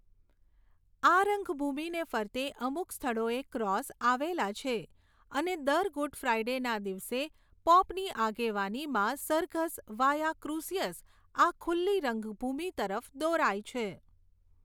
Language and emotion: Gujarati, neutral